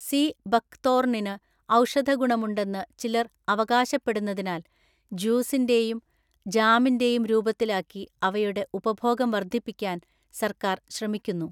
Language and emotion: Malayalam, neutral